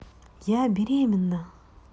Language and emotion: Russian, positive